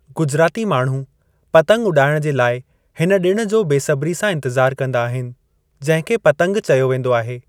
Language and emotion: Sindhi, neutral